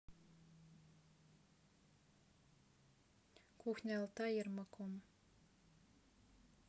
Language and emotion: Russian, neutral